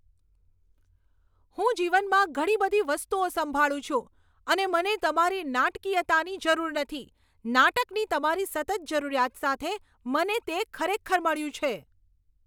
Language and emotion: Gujarati, angry